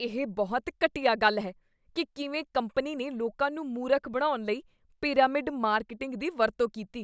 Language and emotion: Punjabi, disgusted